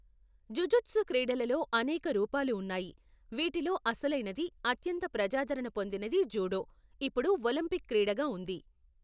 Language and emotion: Telugu, neutral